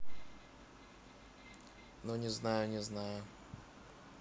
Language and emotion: Russian, neutral